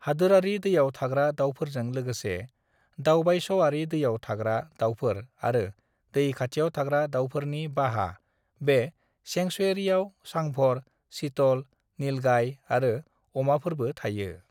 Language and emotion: Bodo, neutral